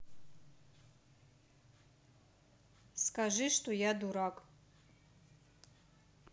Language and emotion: Russian, neutral